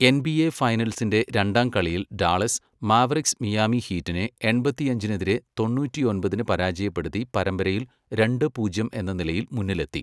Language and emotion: Malayalam, neutral